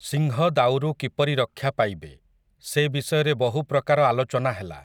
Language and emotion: Odia, neutral